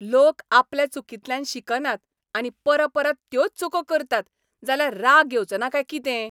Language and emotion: Goan Konkani, angry